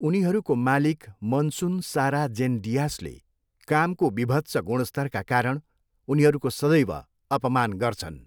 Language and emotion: Nepali, neutral